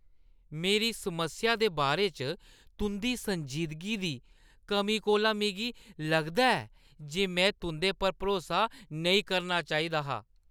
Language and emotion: Dogri, disgusted